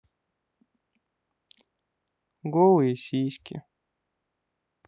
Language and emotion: Russian, sad